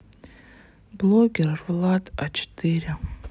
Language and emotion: Russian, sad